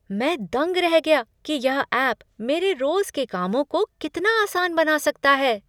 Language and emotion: Hindi, surprised